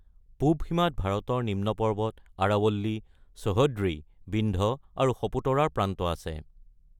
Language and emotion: Assamese, neutral